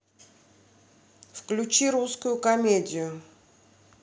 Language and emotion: Russian, neutral